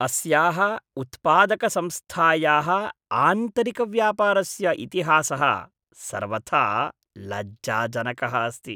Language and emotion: Sanskrit, disgusted